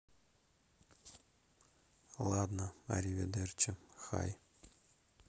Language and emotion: Russian, neutral